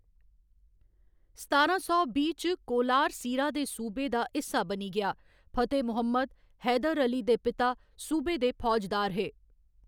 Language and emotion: Dogri, neutral